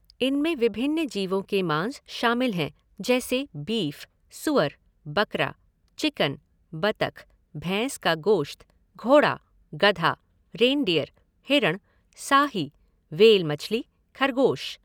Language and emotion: Hindi, neutral